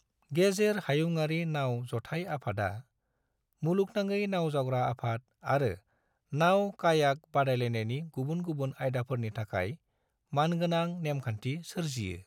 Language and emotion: Bodo, neutral